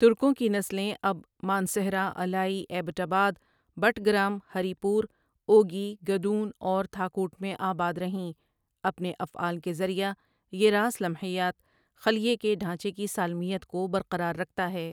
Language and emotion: Urdu, neutral